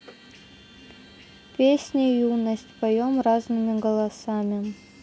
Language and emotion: Russian, neutral